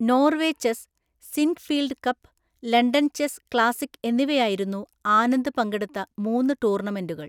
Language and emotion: Malayalam, neutral